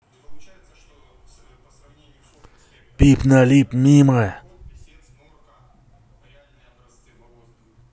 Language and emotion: Russian, angry